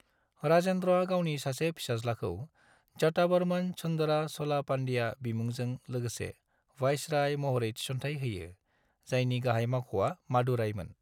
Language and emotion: Bodo, neutral